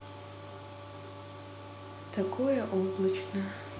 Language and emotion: Russian, neutral